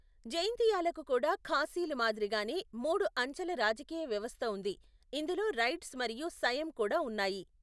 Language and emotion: Telugu, neutral